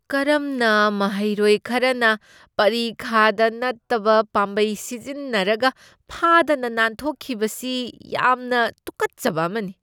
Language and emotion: Manipuri, disgusted